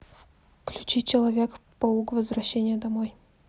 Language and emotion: Russian, neutral